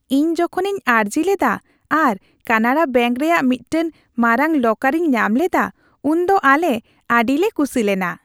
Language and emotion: Santali, happy